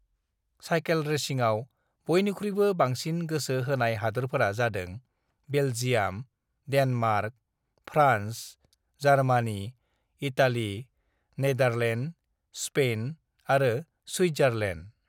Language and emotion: Bodo, neutral